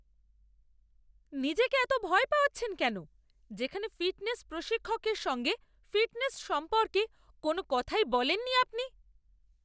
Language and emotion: Bengali, angry